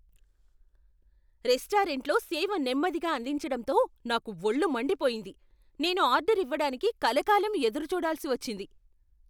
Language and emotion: Telugu, angry